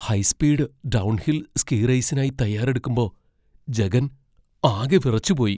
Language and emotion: Malayalam, fearful